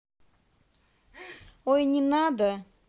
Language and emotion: Russian, neutral